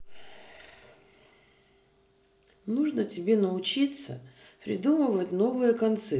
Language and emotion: Russian, neutral